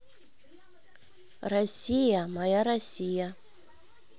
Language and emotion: Russian, neutral